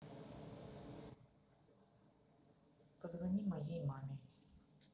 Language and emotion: Russian, neutral